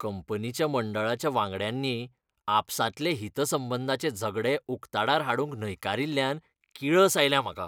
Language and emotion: Goan Konkani, disgusted